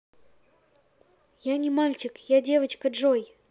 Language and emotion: Russian, neutral